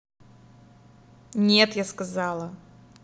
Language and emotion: Russian, angry